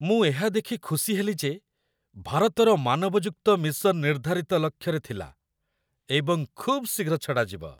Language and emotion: Odia, happy